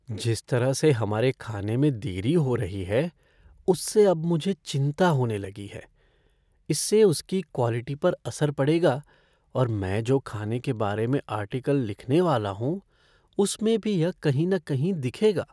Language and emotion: Hindi, fearful